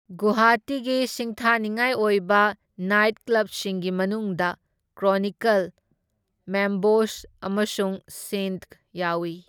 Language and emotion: Manipuri, neutral